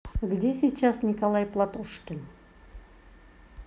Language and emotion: Russian, neutral